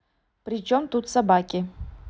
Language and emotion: Russian, neutral